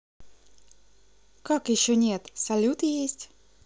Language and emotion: Russian, positive